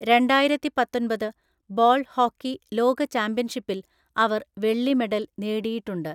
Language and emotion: Malayalam, neutral